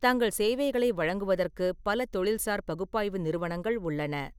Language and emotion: Tamil, neutral